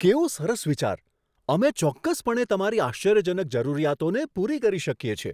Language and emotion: Gujarati, surprised